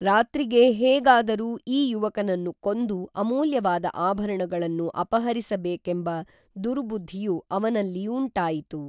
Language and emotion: Kannada, neutral